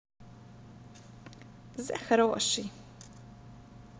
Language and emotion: Russian, positive